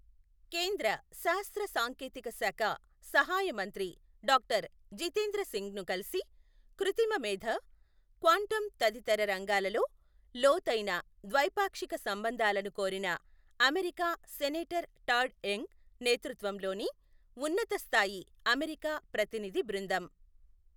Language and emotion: Telugu, neutral